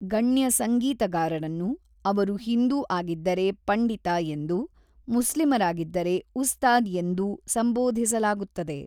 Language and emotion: Kannada, neutral